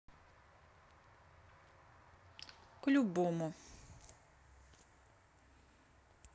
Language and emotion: Russian, neutral